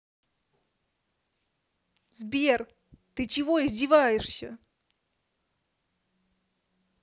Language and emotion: Russian, angry